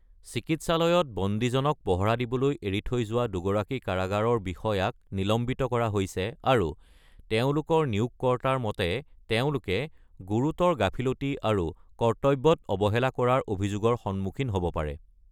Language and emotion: Assamese, neutral